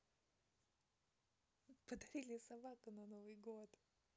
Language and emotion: Russian, positive